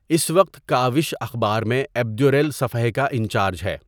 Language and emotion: Urdu, neutral